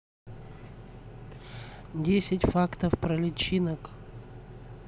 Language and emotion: Russian, neutral